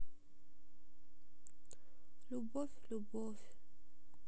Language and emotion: Russian, sad